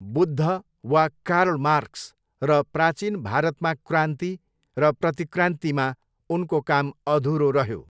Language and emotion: Nepali, neutral